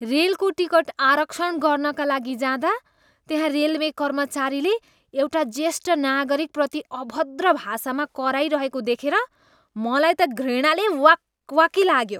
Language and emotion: Nepali, disgusted